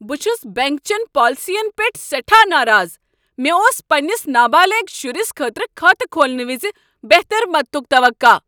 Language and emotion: Kashmiri, angry